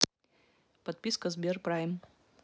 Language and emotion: Russian, neutral